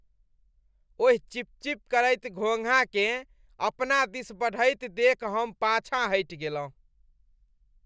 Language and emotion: Maithili, disgusted